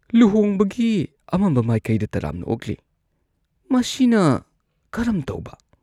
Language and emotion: Manipuri, disgusted